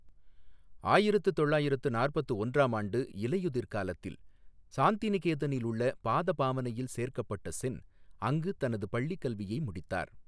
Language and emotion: Tamil, neutral